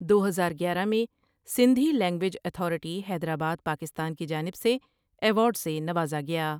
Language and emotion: Urdu, neutral